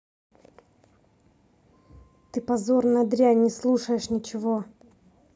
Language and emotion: Russian, angry